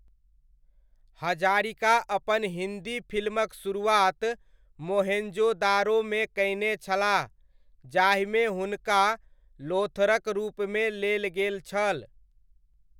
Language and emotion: Maithili, neutral